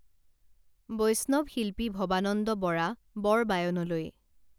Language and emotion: Assamese, neutral